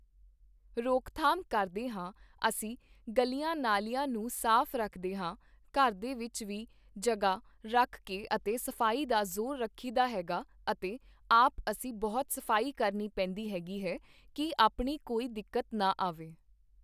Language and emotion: Punjabi, neutral